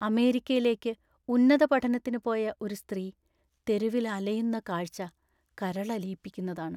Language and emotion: Malayalam, sad